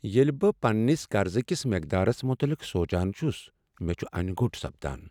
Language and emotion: Kashmiri, sad